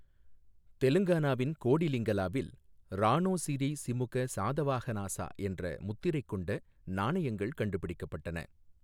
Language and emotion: Tamil, neutral